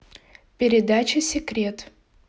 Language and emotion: Russian, neutral